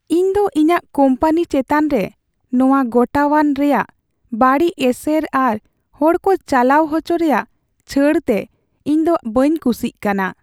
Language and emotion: Santali, sad